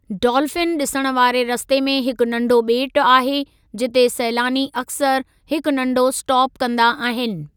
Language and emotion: Sindhi, neutral